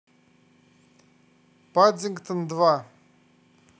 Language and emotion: Russian, neutral